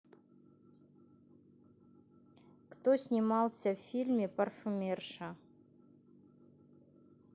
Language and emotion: Russian, neutral